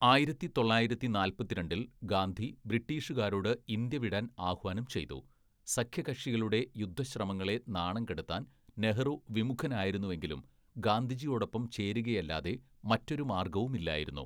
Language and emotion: Malayalam, neutral